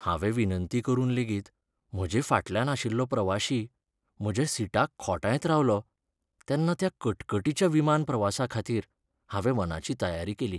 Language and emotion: Goan Konkani, sad